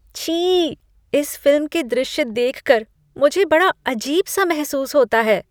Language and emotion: Hindi, disgusted